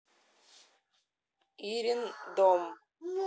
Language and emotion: Russian, neutral